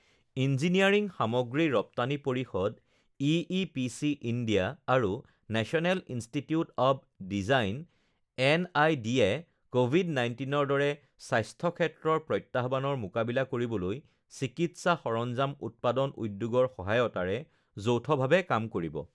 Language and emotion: Assamese, neutral